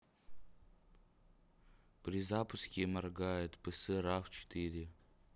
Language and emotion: Russian, neutral